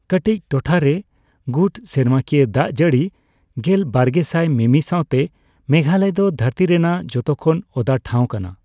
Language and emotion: Santali, neutral